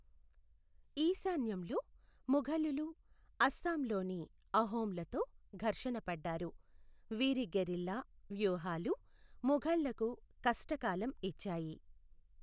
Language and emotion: Telugu, neutral